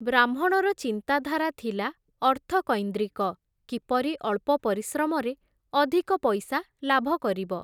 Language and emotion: Odia, neutral